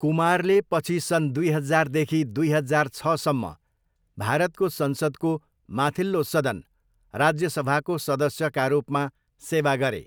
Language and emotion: Nepali, neutral